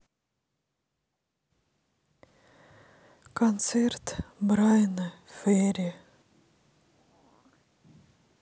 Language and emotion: Russian, sad